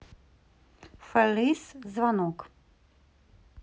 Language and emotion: Russian, neutral